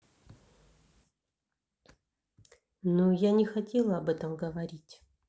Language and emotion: Russian, neutral